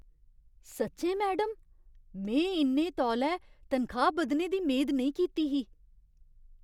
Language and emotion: Dogri, surprised